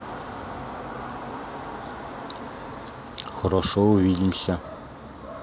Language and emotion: Russian, neutral